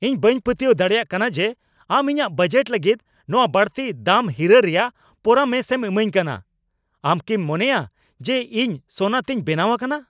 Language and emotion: Santali, angry